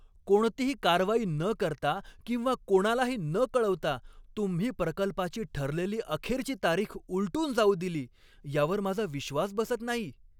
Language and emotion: Marathi, angry